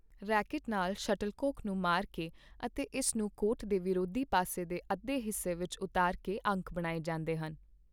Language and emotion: Punjabi, neutral